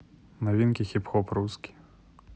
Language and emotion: Russian, neutral